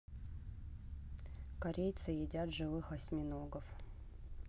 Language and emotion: Russian, neutral